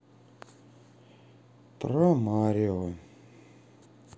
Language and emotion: Russian, sad